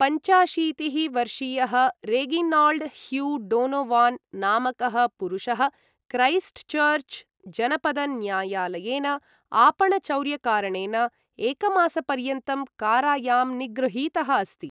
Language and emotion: Sanskrit, neutral